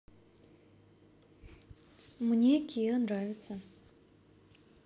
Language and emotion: Russian, neutral